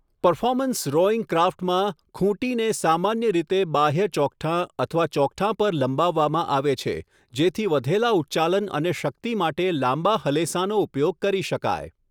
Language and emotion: Gujarati, neutral